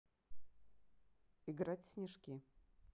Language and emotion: Russian, neutral